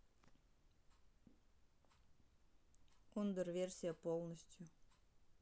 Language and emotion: Russian, neutral